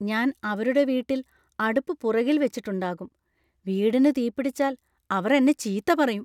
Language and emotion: Malayalam, fearful